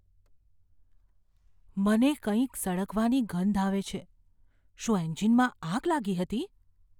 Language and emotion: Gujarati, fearful